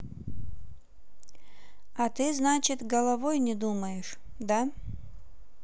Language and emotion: Russian, neutral